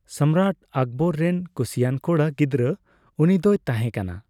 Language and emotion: Santali, neutral